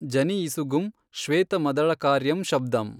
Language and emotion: Kannada, neutral